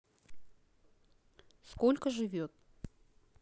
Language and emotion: Russian, neutral